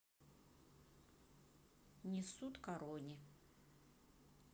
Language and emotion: Russian, neutral